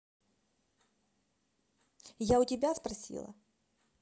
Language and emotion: Russian, angry